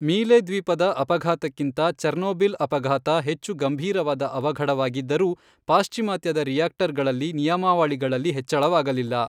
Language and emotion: Kannada, neutral